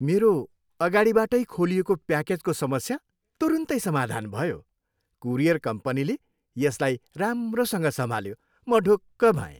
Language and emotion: Nepali, happy